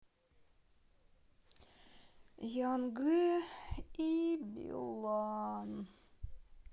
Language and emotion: Russian, sad